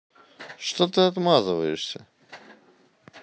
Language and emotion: Russian, neutral